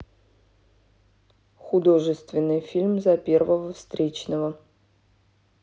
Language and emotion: Russian, neutral